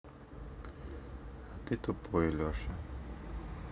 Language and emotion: Russian, neutral